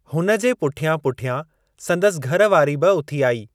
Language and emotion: Sindhi, neutral